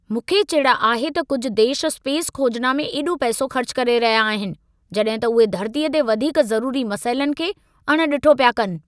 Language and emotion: Sindhi, angry